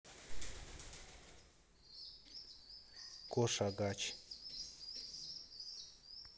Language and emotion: Russian, neutral